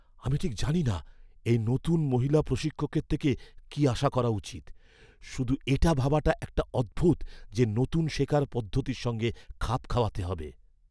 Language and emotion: Bengali, fearful